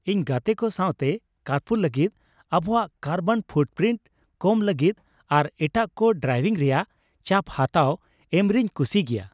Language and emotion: Santali, happy